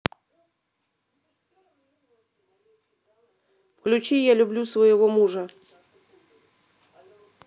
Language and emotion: Russian, neutral